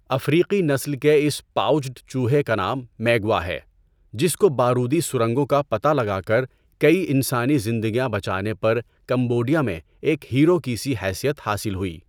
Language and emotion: Urdu, neutral